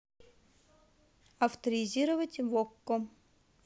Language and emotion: Russian, neutral